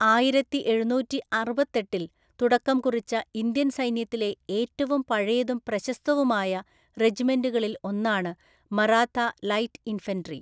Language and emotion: Malayalam, neutral